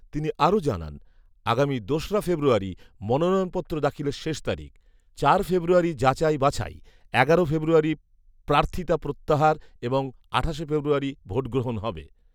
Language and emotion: Bengali, neutral